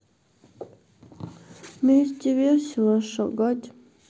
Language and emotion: Russian, sad